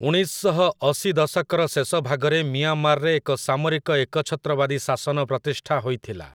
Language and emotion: Odia, neutral